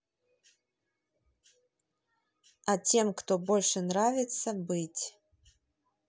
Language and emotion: Russian, neutral